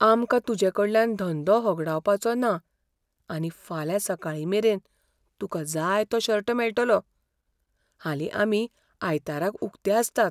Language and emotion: Goan Konkani, fearful